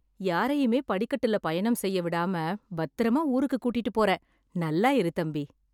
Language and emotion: Tamil, happy